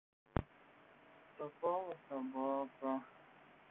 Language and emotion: Russian, sad